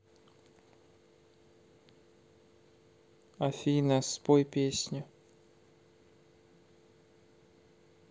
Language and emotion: Russian, sad